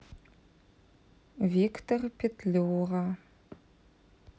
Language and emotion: Russian, neutral